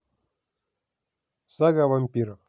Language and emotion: Russian, neutral